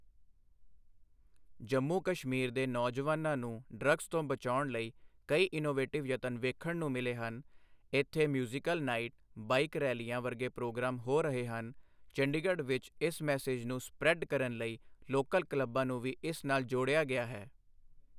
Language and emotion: Punjabi, neutral